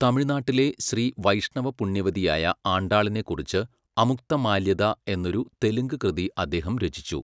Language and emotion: Malayalam, neutral